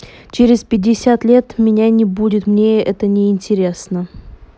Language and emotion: Russian, neutral